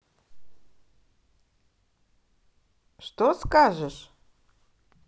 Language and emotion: Russian, positive